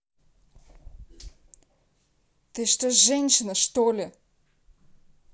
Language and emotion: Russian, angry